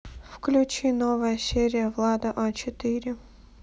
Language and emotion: Russian, neutral